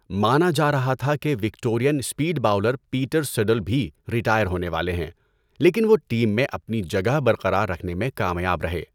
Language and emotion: Urdu, neutral